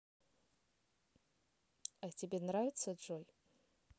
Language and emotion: Russian, neutral